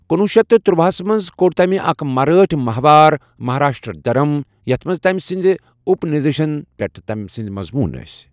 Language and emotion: Kashmiri, neutral